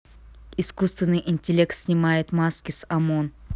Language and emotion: Russian, neutral